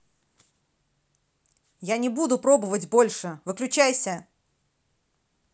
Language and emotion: Russian, angry